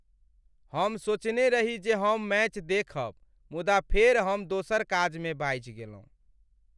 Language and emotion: Maithili, sad